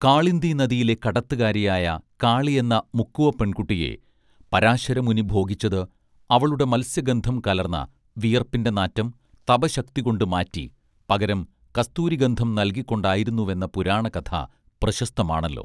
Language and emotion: Malayalam, neutral